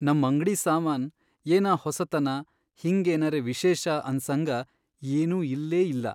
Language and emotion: Kannada, sad